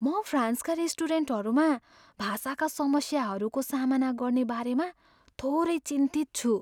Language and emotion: Nepali, fearful